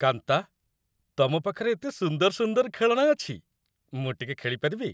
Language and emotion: Odia, happy